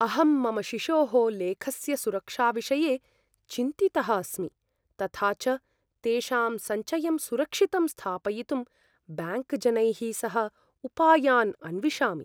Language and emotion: Sanskrit, fearful